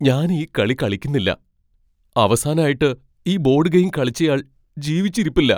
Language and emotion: Malayalam, fearful